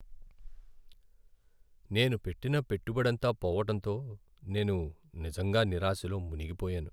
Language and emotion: Telugu, sad